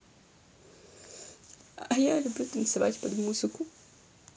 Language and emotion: Russian, sad